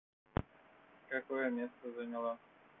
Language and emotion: Russian, neutral